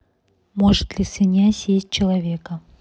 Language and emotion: Russian, neutral